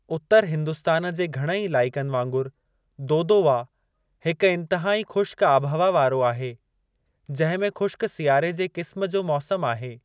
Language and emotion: Sindhi, neutral